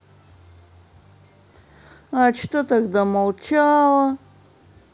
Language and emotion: Russian, neutral